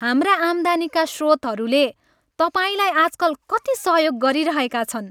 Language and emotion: Nepali, happy